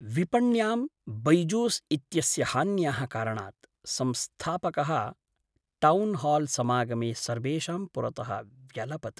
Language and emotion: Sanskrit, sad